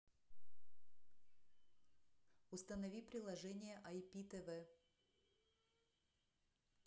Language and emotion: Russian, neutral